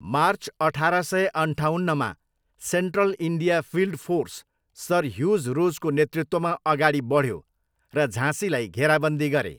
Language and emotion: Nepali, neutral